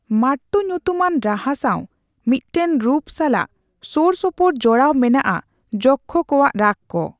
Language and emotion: Santali, neutral